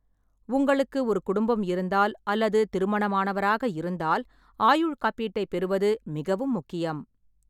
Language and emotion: Tamil, neutral